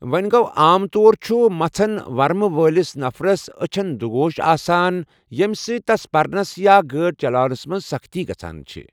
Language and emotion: Kashmiri, neutral